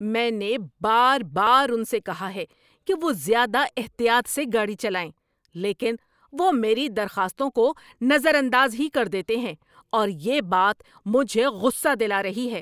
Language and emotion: Urdu, angry